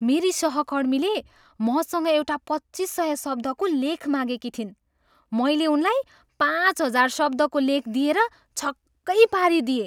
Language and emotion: Nepali, surprised